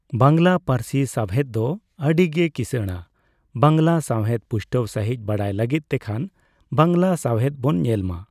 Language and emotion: Santali, neutral